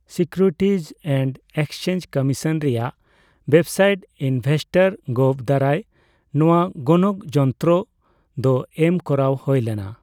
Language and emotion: Santali, neutral